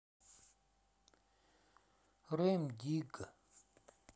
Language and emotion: Russian, sad